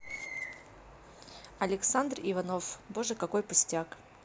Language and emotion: Russian, neutral